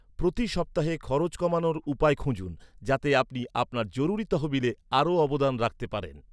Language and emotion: Bengali, neutral